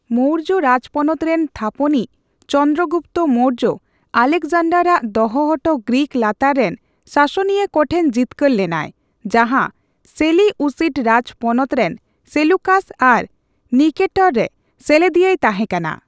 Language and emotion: Santali, neutral